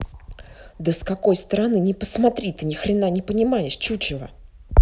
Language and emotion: Russian, angry